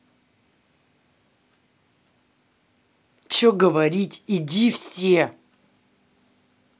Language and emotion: Russian, angry